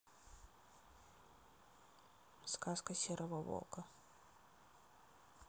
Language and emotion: Russian, neutral